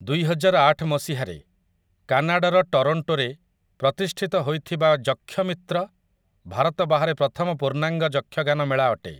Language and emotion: Odia, neutral